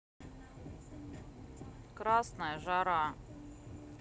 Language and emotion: Russian, sad